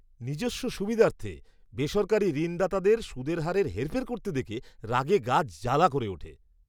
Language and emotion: Bengali, disgusted